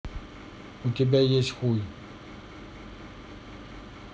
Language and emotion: Russian, neutral